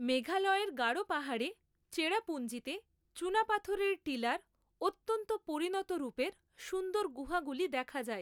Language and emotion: Bengali, neutral